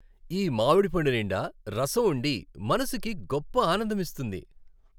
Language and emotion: Telugu, happy